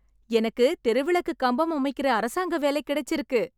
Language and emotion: Tamil, happy